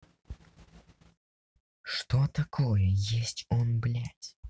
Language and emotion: Russian, angry